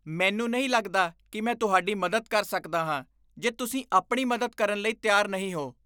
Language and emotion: Punjabi, disgusted